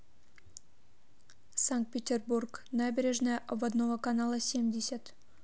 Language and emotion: Russian, neutral